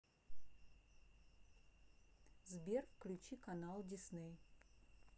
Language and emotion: Russian, neutral